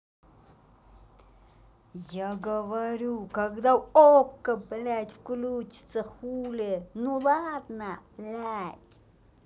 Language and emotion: Russian, angry